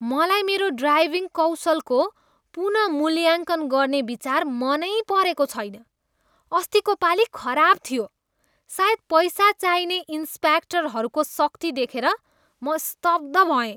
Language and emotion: Nepali, disgusted